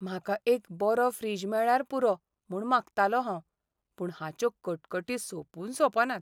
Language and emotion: Goan Konkani, sad